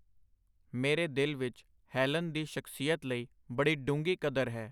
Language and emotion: Punjabi, neutral